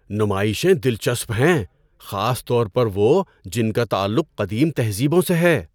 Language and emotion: Urdu, surprised